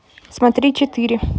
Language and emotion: Russian, neutral